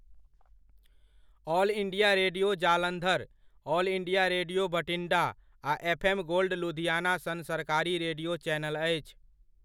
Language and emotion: Maithili, neutral